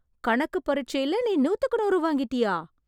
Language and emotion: Tamil, surprised